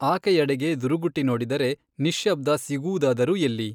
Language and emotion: Kannada, neutral